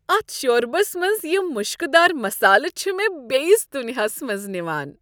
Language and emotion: Kashmiri, happy